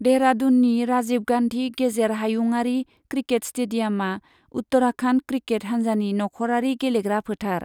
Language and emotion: Bodo, neutral